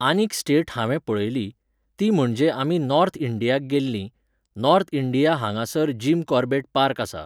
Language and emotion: Goan Konkani, neutral